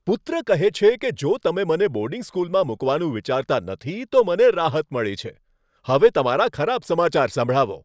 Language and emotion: Gujarati, happy